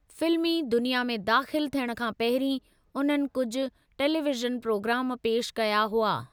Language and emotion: Sindhi, neutral